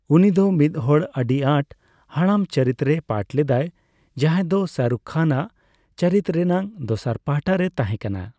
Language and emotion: Santali, neutral